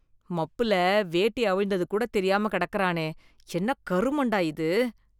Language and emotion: Tamil, disgusted